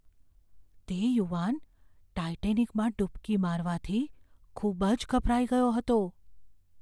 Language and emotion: Gujarati, fearful